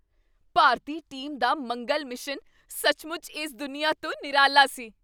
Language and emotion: Punjabi, surprised